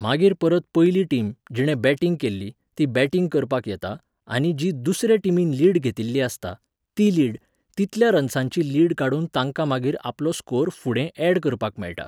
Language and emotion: Goan Konkani, neutral